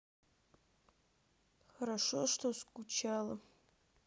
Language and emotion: Russian, sad